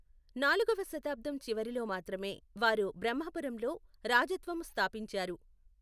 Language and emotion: Telugu, neutral